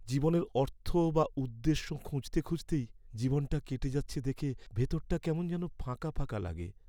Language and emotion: Bengali, sad